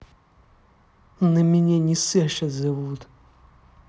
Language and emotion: Russian, angry